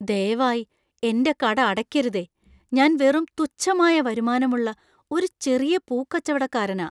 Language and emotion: Malayalam, fearful